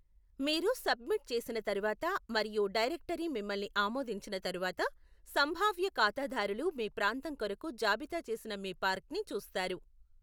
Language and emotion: Telugu, neutral